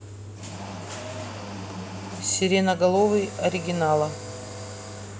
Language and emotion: Russian, neutral